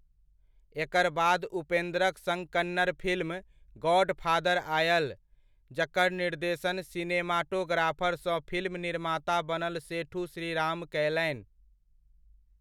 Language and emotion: Maithili, neutral